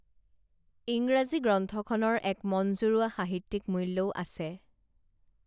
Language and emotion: Assamese, neutral